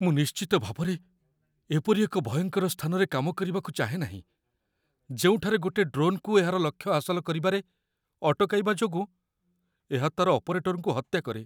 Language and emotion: Odia, fearful